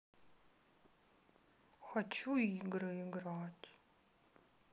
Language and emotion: Russian, sad